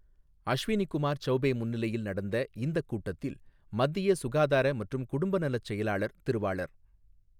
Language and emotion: Tamil, neutral